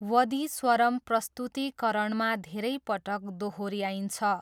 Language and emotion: Nepali, neutral